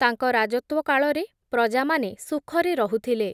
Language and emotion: Odia, neutral